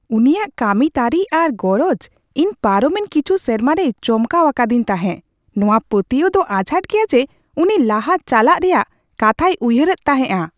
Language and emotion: Santali, surprised